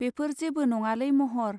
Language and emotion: Bodo, neutral